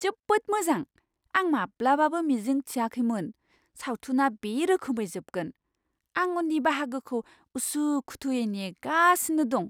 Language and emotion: Bodo, surprised